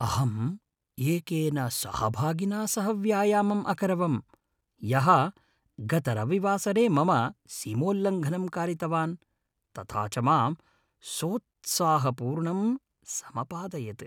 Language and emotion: Sanskrit, happy